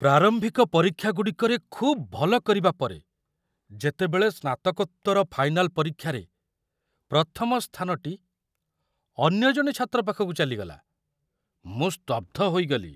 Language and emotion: Odia, surprised